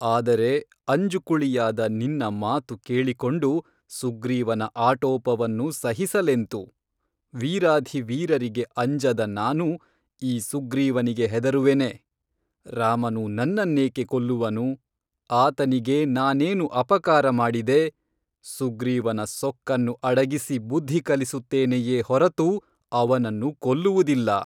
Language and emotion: Kannada, neutral